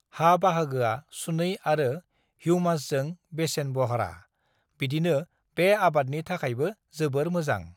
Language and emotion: Bodo, neutral